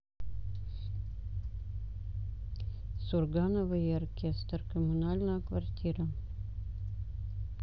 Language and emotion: Russian, neutral